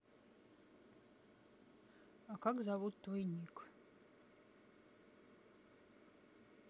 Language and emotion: Russian, neutral